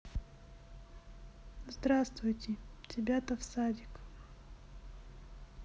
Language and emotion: Russian, sad